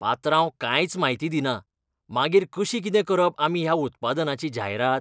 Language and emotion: Goan Konkani, disgusted